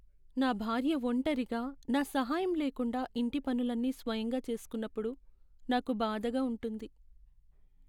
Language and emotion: Telugu, sad